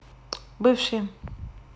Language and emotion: Russian, neutral